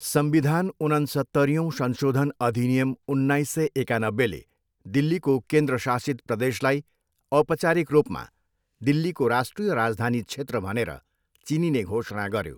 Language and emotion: Nepali, neutral